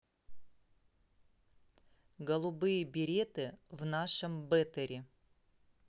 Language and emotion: Russian, neutral